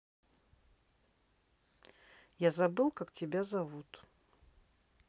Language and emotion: Russian, neutral